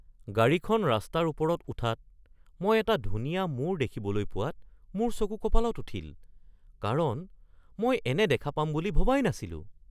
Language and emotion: Assamese, surprised